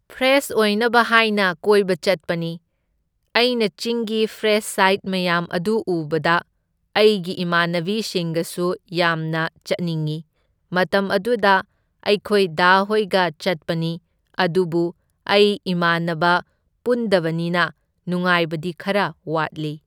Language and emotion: Manipuri, neutral